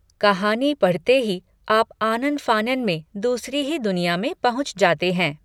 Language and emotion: Hindi, neutral